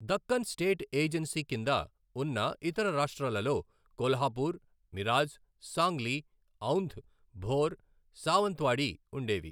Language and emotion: Telugu, neutral